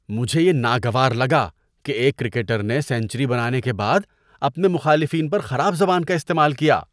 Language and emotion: Urdu, disgusted